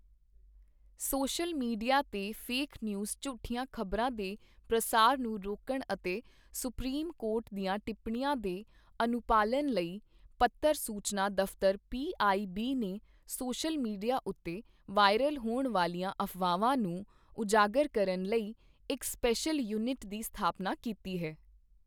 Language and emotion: Punjabi, neutral